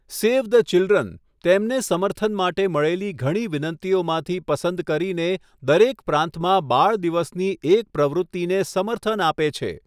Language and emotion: Gujarati, neutral